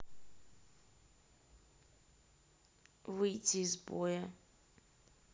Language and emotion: Russian, sad